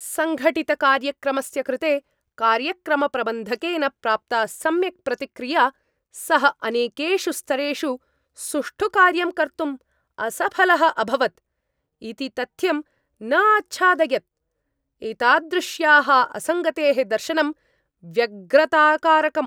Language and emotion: Sanskrit, angry